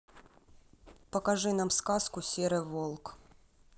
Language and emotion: Russian, neutral